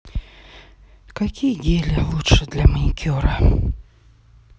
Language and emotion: Russian, sad